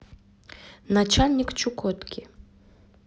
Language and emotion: Russian, neutral